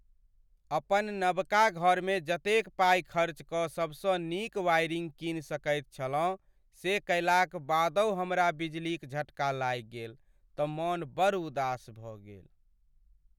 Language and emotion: Maithili, sad